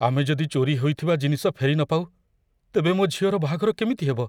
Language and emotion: Odia, fearful